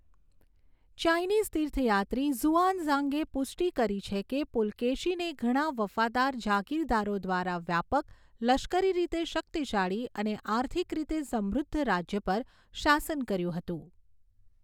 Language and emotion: Gujarati, neutral